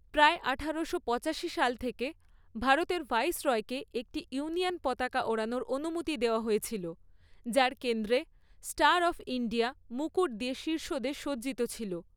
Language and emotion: Bengali, neutral